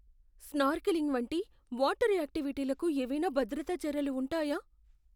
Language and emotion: Telugu, fearful